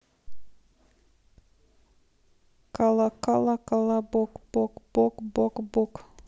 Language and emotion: Russian, neutral